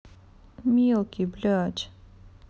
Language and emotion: Russian, sad